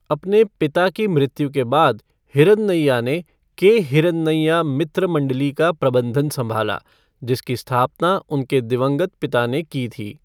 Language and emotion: Hindi, neutral